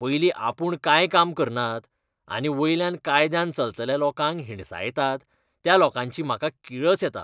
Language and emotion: Goan Konkani, disgusted